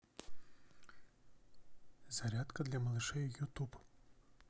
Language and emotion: Russian, neutral